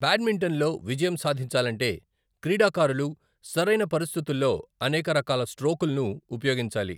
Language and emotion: Telugu, neutral